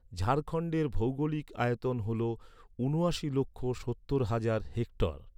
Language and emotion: Bengali, neutral